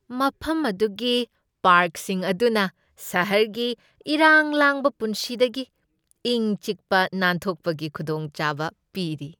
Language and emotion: Manipuri, happy